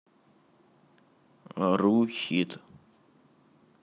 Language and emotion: Russian, neutral